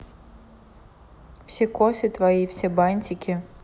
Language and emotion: Russian, neutral